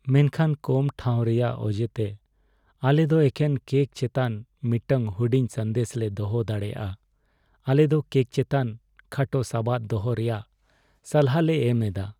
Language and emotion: Santali, sad